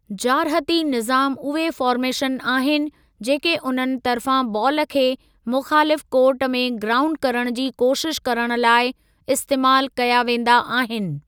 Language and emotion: Sindhi, neutral